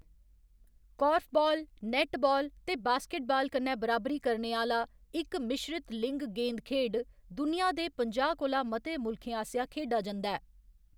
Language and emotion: Dogri, neutral